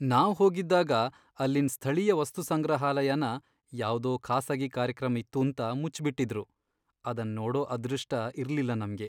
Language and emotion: Kannada, sad